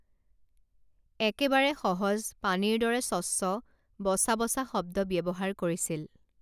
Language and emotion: Assamese, neutral